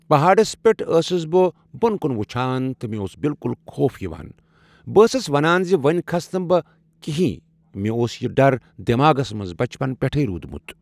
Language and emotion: Kashmiri, neutral